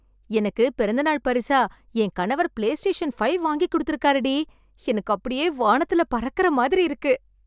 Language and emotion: Tamil, happy